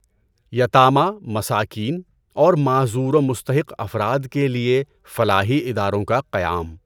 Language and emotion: Urdu, neutral